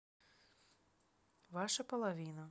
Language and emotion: Russian, neutral